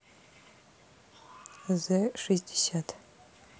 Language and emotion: Russian, neutral